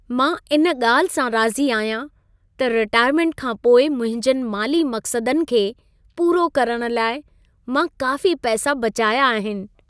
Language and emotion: Sindhi, happy